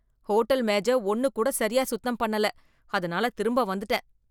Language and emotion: Tamil, disgusted